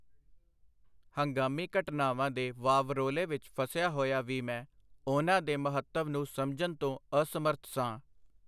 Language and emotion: Punjabi, neutral